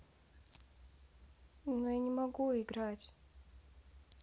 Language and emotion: Russian, sad